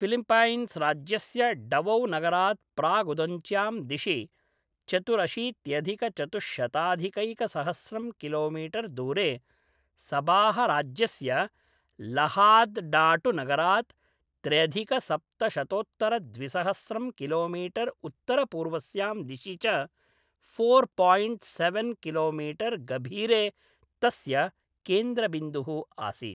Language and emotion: Sanskrit, neutral